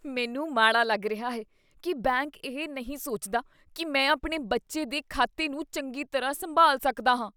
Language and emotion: Punjabi, disgusted